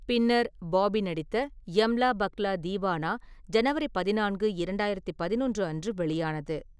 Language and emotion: Tamil, neutral